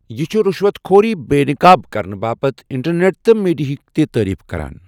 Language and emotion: Kashmiri, neutral